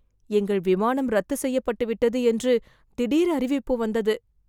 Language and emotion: Tamil, fearful